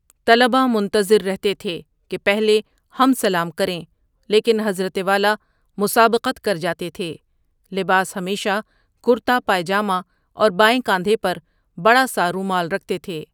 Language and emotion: Urdu, neutral